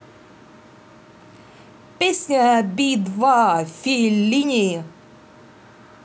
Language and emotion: Russian, positive